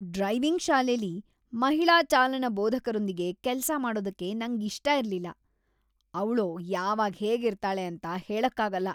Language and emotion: Kannada, disgusted